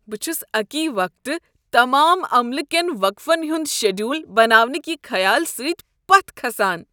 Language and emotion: Kashmiri, disgusted